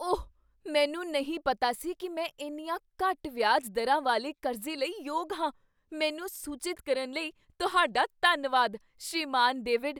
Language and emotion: Punjabi, surprised